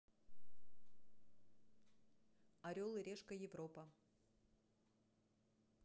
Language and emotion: Russian, neutral